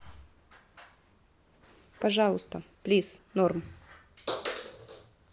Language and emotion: Russian, neutral